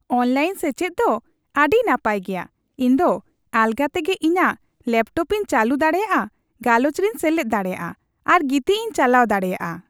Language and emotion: Santali, happy